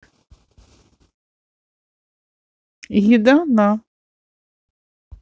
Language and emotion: Russian, neutral